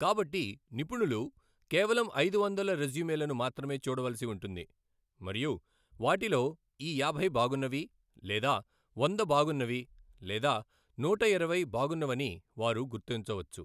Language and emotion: Telugu, neutral